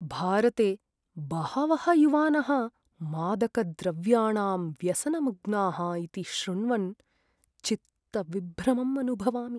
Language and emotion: Sanskrit, sad